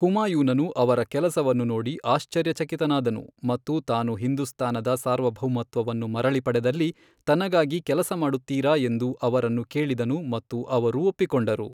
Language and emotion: Kannada, neutral